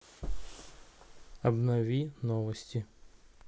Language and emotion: Russian, neutral